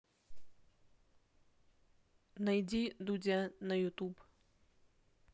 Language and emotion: Russian, neutral